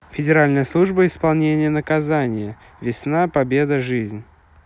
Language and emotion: Russian, neutral